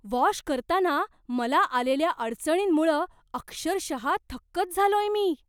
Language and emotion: Marathi, surprised